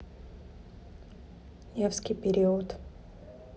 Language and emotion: Russian, neutral